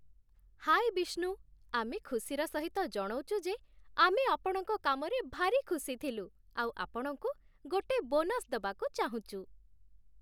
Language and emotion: Odia, happy